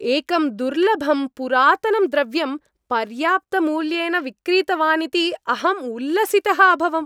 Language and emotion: Sanskrit, happy